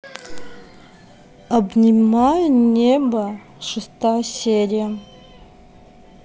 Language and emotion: Russian, neutral